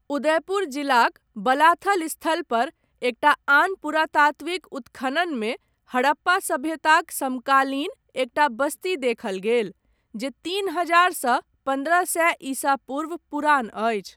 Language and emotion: Maithili, neutral